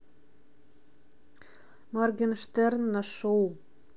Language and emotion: Russian, neutral